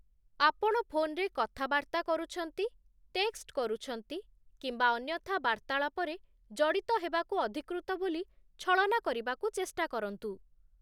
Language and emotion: Odia, neutral